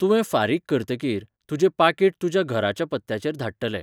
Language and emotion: Goan Konkani, neutral